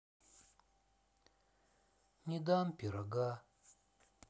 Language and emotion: Russian, sad